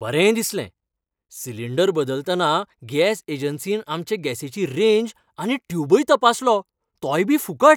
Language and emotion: Goan Konkani, happy